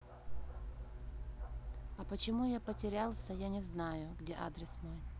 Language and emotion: Russian, neutral